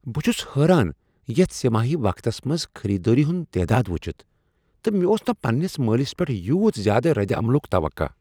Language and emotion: Kashmiri, surprised